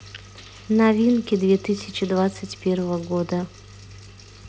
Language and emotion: Russian, neutral